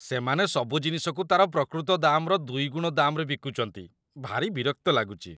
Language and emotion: Odia, disgusted